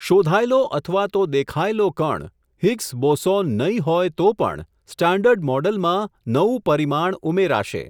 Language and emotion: Gujarati, neutral